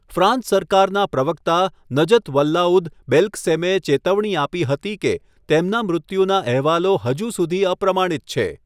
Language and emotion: Gujarati, neutral